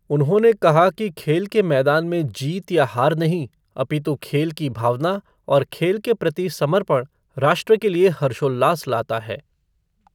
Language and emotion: Hindi, neutral